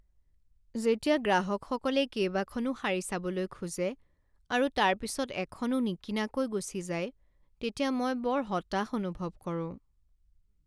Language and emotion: Assamese, sad